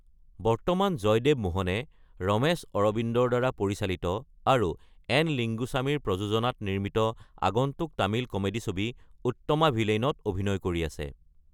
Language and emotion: Assamese, neutral